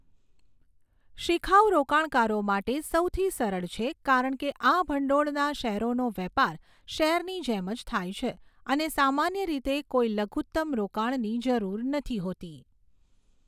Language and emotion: Gujarati, neutral